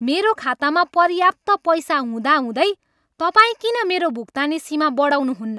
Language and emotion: Nepali, angry